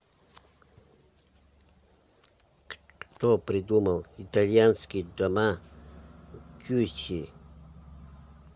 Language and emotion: Russian, neutral